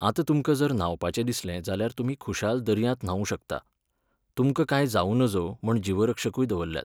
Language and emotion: Goan Konkani, neutral